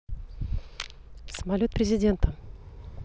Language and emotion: Russian, neutral